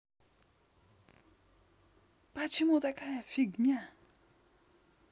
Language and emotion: Russian, neutral